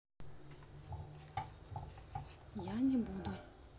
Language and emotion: Russian, neutral